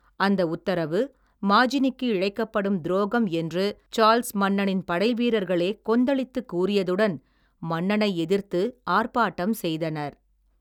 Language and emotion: Tamil, neutral